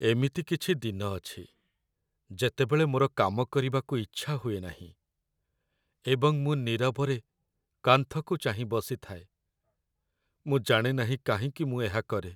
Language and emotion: Odia, sad